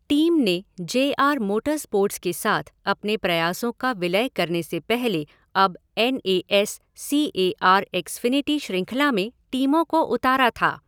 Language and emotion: Hindi, neutral